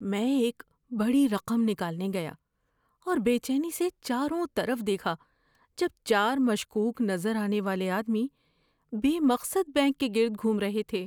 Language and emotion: Urdu, fearful